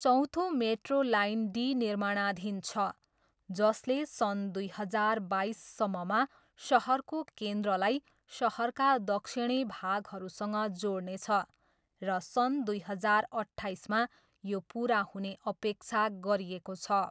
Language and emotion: Nepali, neutral